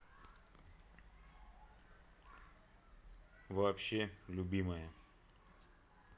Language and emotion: Russian, neutral